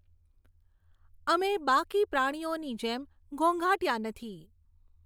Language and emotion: Gujarati, neutral